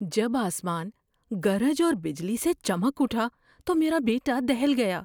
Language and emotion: Urdu, fearful